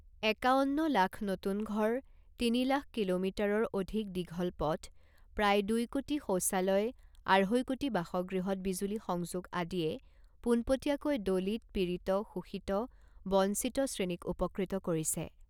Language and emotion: Assamese, neutral